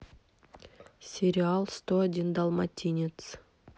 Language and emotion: Russian, neutral